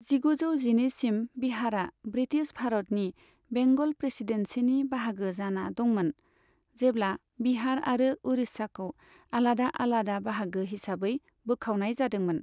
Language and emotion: Bodo, neutral